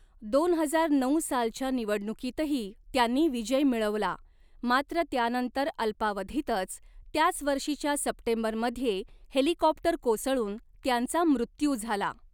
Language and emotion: Marathi, neutral